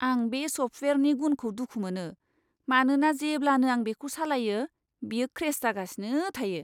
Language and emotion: Bodo, disgusted